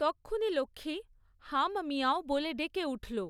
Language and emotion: Bengali, neutral